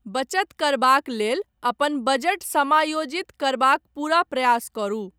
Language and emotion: Maithili, neutral